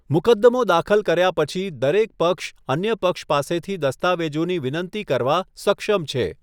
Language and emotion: Gujarati, neutral